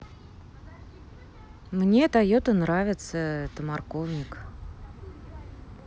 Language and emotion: Russian, neutral